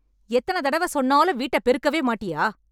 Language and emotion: Tamil, angry